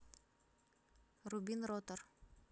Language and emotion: Russian, neutral